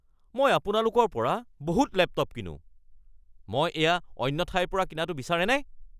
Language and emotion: Assamese, angry